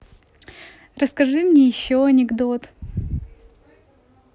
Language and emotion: Russian, positive